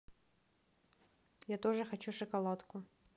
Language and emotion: Russian, neutral